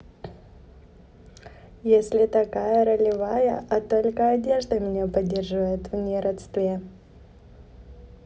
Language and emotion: Russian, neutral